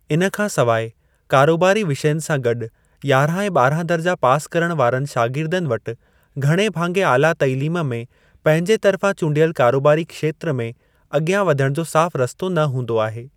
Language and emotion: Sindhi, neutral